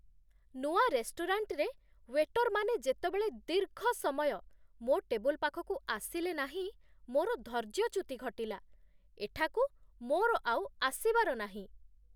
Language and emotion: Odia, disgusted